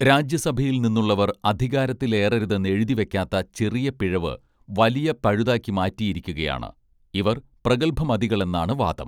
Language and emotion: Malayalam, neutral